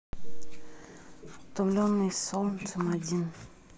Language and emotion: Russian, neutral